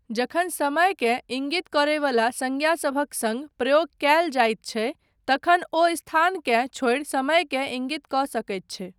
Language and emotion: Maithili, neutral